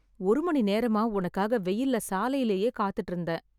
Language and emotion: Tamil, sad